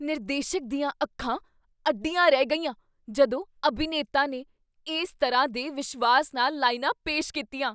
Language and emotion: Punjabi, surprised